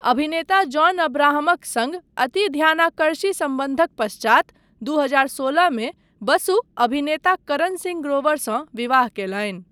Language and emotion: Maithili, neutral